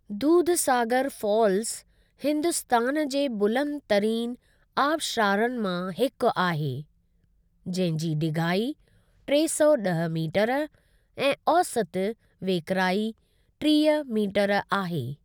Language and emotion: Sindhi, neutral